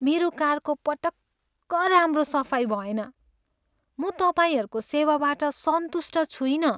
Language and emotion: Nepali, sad